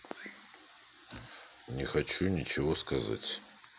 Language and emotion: Russian, neutral